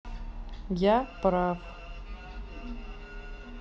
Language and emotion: Russian, neutral